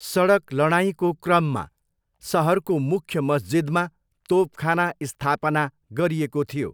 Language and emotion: Nepali, neutral